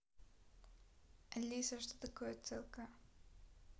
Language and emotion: Russian, neutral